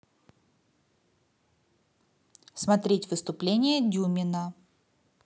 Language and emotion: Russian, positive